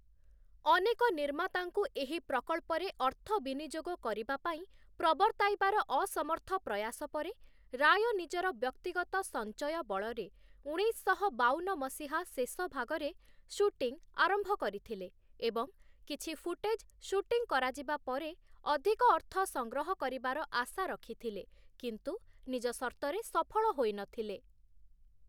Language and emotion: Odia, neutral